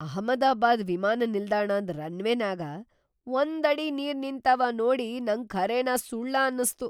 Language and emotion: Kannada, surprised